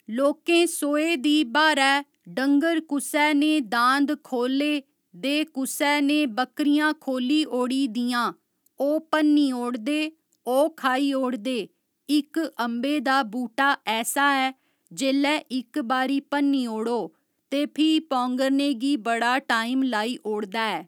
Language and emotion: Dogri, neutral